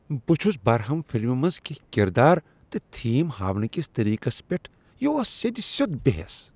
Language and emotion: Kashmiri, disgusted